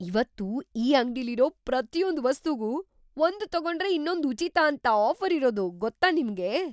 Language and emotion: Kannada, surprised